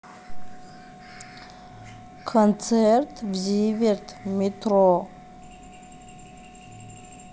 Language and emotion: Russian, neutral